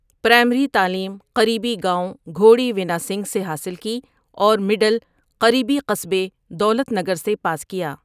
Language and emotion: Urdu, neutral